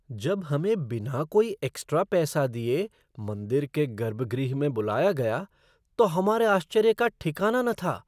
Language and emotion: Hindi, surprised